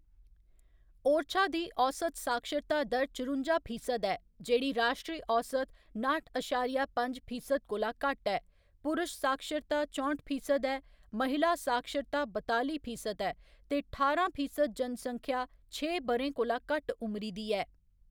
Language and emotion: Dogri, neutral